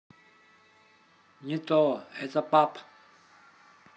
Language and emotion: Russian, neutral